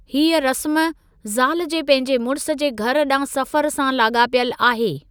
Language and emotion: Sindhi, neutral